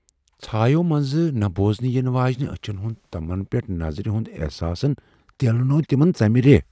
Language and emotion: Kashmiri, fearful